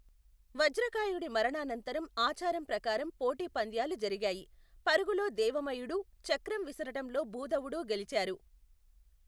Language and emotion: Telugu, neutral